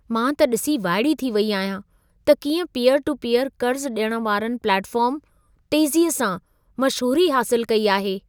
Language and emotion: Sindhi, surprised